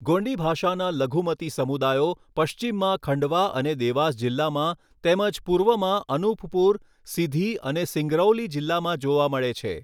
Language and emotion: Gujarati, neutral